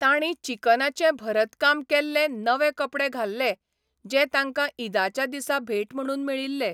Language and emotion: Goan Konkani, neutral